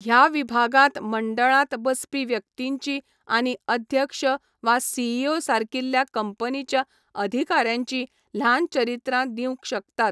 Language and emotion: Goan Konkani, neutral